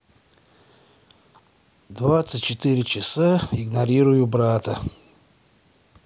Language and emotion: Russian, sad